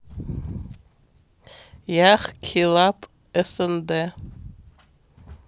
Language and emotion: Russian, neutral